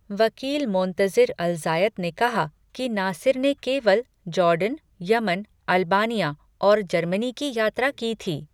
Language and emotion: Hindi, neutral